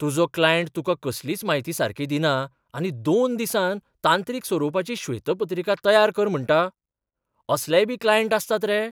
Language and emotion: Goan Konkani, surprised